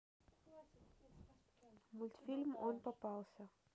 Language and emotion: Russian, neutral